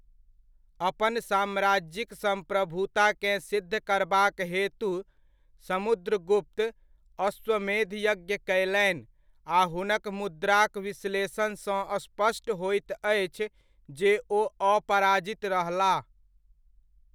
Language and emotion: Maithili, neutral